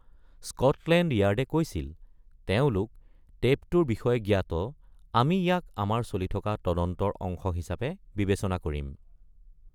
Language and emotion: Assamese, neutral